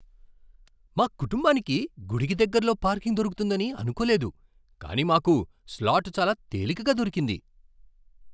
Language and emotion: Telugu, surprised